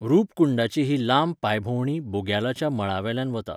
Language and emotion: Goan Konkani, neutral